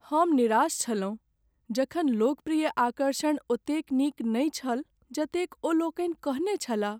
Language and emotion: Maithili, sad